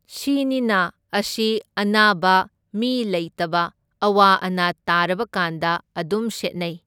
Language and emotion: Manipuri, neutral